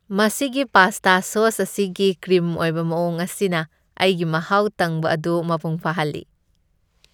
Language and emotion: Manipuri, happy